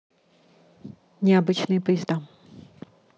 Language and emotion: Russian, neutral